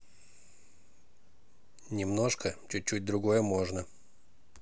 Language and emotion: Russian, neutral